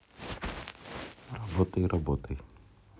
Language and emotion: Russian, neutral